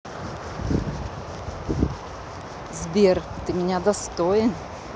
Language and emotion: Russian, neutral